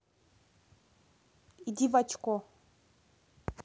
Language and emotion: Russian, neutral